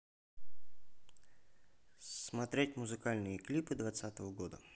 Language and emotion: Russian, neutral